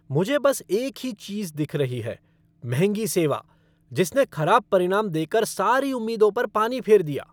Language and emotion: Hindi, angry